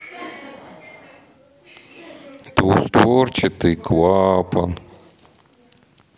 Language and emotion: Russian, sad